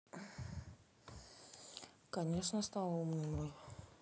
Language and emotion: Russian, neutral